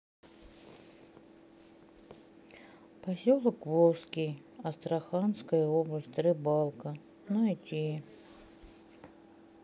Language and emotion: Russian, sad